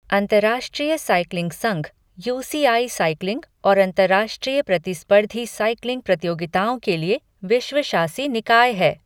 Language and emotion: Hindi, neutral